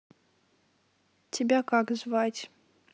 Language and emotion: Russian, neutral